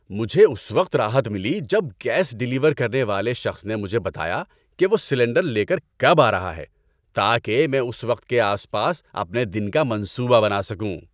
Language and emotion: Urdu, happy